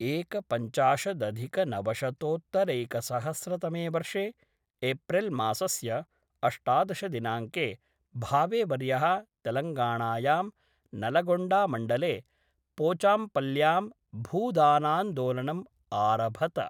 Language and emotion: Sanskrit, neutral